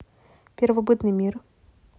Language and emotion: Russian, neutral